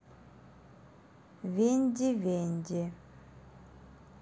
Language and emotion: Russian, neutral